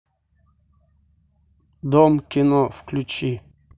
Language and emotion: Russian, neutral